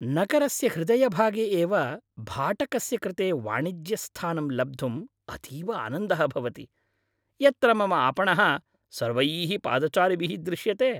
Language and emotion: Sanskrit, happy